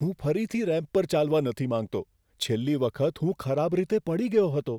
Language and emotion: Gujarati, fearful